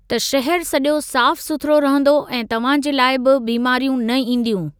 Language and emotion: Sindhi, neutral